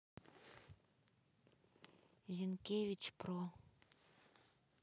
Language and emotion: Russian, neutral